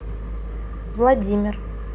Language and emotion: Russian, neutral